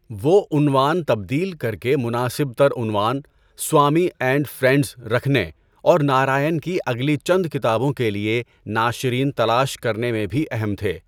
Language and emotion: Urdu, neutral